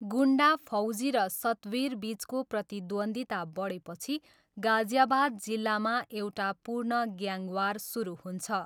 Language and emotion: Nepali, neutral